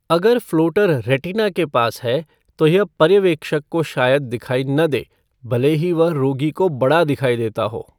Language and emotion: Hindi, neutral